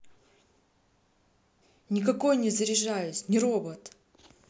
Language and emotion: Russian, angry